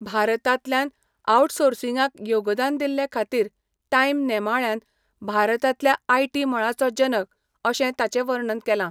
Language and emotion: Goan Konkani, neutral